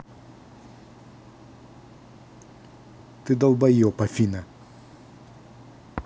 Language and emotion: Russian, angry